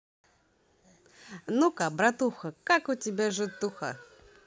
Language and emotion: Russian, positive